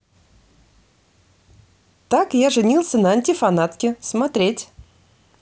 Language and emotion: Russian, positive